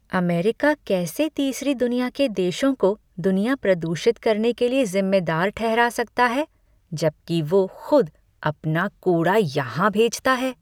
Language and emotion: Hindi, disgusted